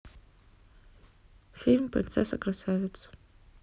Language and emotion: Russian, neutral